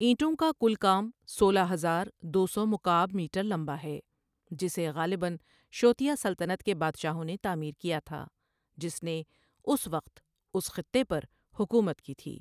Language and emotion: Urdu, neutral